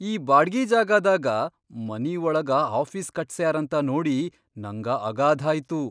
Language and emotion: Kannada, surprised